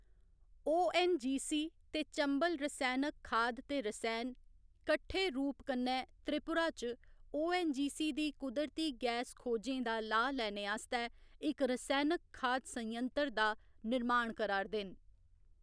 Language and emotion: Dogri, neutral